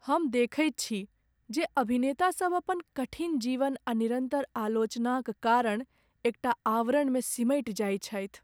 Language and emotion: Maithili, sad